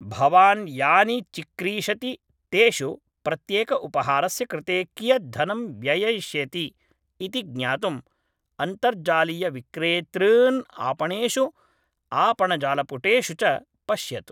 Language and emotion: Sanskrit, neutral